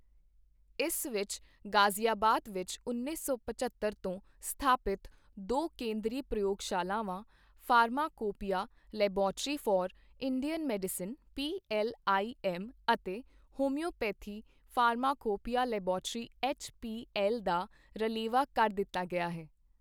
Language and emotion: Punjabi, neutral